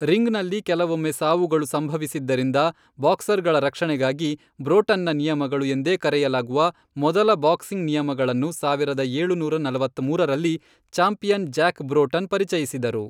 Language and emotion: Kannada, neutral